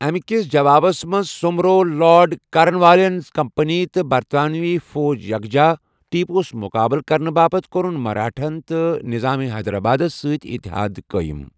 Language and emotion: Kashmiri, neutral